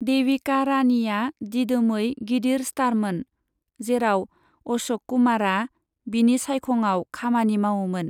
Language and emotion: Bodo, neutral